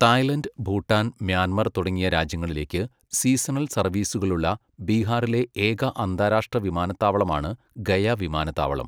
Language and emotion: Malayalam, neutral